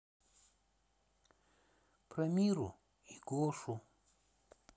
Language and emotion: Russian, sad